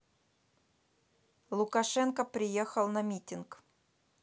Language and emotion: Russian, neutral